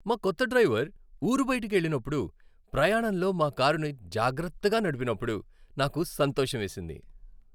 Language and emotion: Telugu, happy